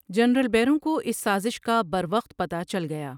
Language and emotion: Urdu, neutral